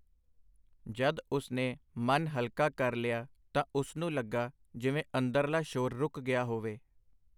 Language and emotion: Punjabi, neutral